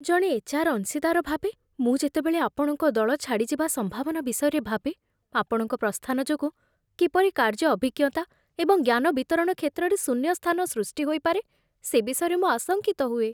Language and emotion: Odia, fearful